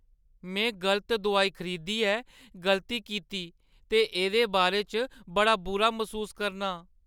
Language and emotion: Dogri, sad